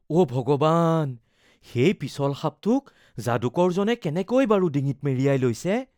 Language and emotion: Assamese, fearful